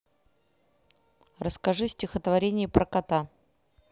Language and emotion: Russian, neutral